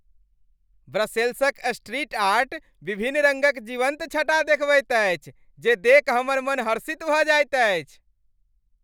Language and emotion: Maithili, happy